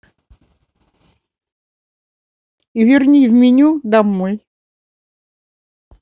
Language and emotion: Russian, neutral